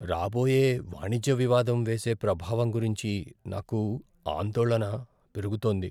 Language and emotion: Telugu, fearful